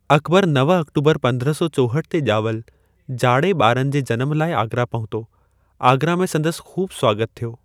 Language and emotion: Sindhi, neutral